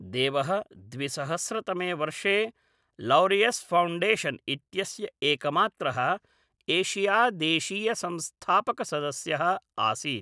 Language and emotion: Sanskrit, neutral